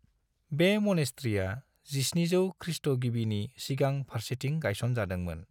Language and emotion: Bodo, neutral